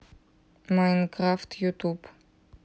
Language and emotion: Russian, neutral